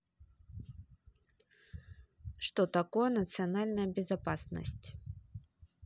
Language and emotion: Russian, neutral